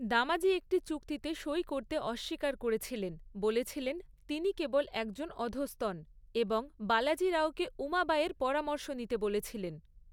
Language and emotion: Bengali, neutral